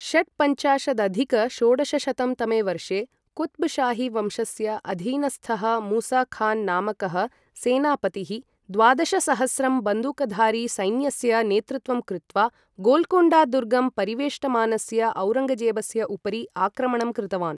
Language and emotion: Sanskrit, neutral